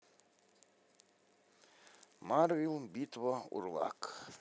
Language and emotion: Russian, neutral